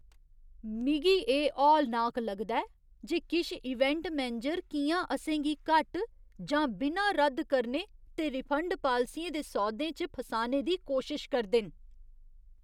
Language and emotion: Dogri, disgusted